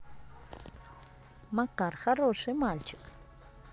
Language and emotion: Russian, positive